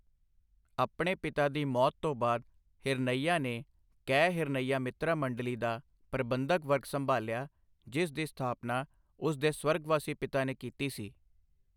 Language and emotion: Punjabi, neutral